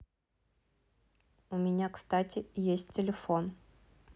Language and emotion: Russian, neutral